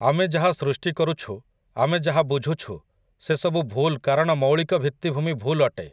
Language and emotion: Odia, neutral